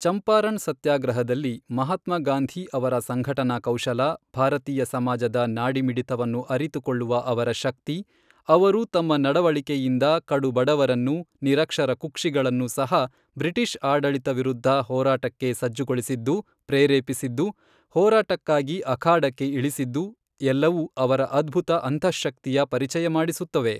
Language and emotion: Kannada, neutral